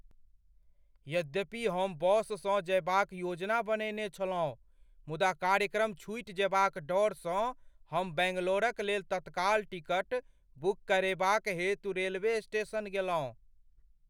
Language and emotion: Maithili, fearful